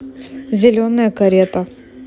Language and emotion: Russian, neutral